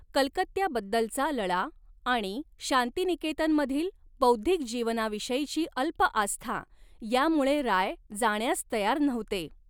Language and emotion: Marathi, neutral